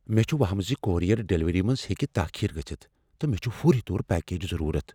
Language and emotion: Kashmiri, fearful